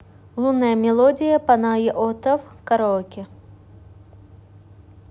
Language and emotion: Russian, neutral